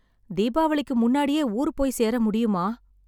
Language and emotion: Tamil, sad